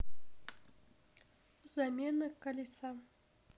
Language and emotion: Russian, neutral